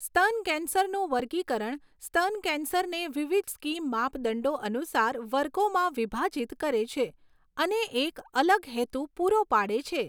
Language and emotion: Gujarati, neutral